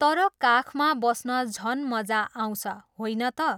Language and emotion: Nepali, neutral